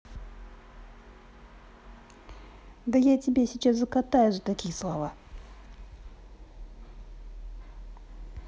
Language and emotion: Russian, angry